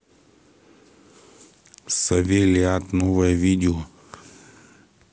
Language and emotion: Russian, neutral